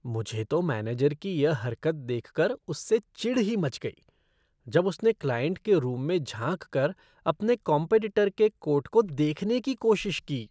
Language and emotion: Hindi, disgusted